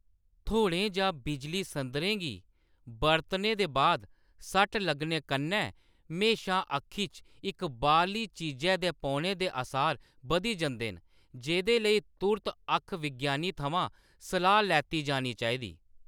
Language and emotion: Dogri, neutral